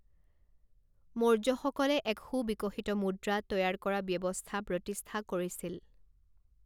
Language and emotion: Assamese, neutral